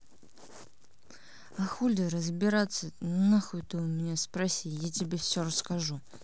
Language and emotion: Russian, angry